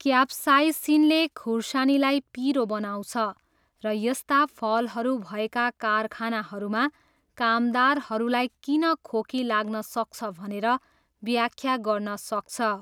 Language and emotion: Nepali, neutral